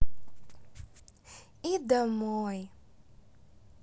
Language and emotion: Russian, positive